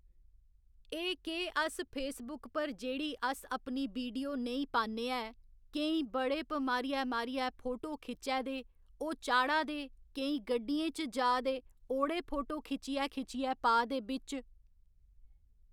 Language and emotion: Dogri, neutral